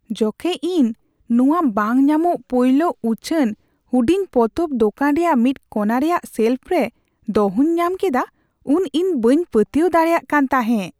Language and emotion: Santali, surprised